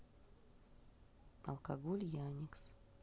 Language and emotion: Russian, neutral